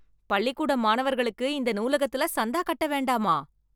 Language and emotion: Tamil, surprised